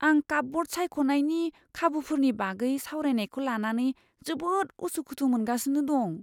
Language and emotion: Bodo, fearful